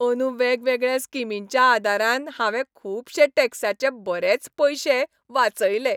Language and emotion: Goan Konkani, happy